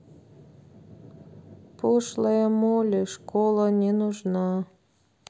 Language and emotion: Russian, sad